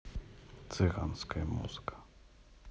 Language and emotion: Russian, neutral